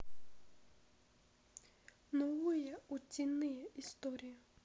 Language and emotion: Russian, sad